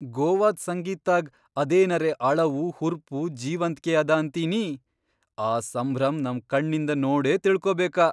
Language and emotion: Kannada, surprised